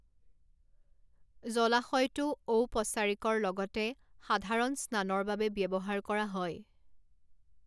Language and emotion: Assamese, neutral